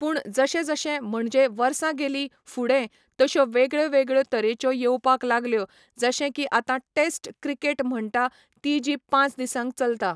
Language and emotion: Goan Konkani, neutral